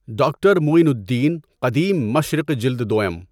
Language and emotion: Urdu, neutral